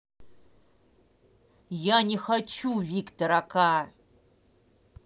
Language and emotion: Russian, angry